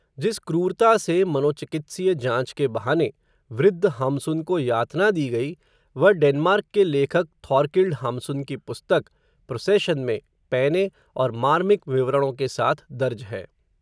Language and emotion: Hindi, neutral